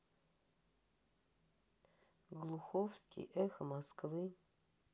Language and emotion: Russian, sad